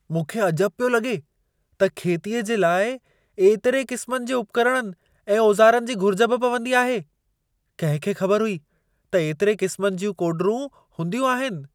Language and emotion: Sindhi, surprised